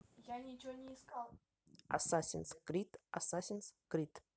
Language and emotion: Russian, neutral